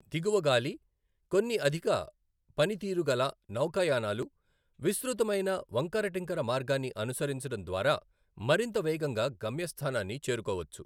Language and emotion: Telugu, neutral